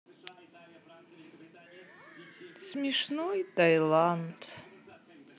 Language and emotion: Russian, sad